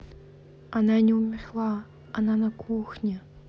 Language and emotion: Russian, neutral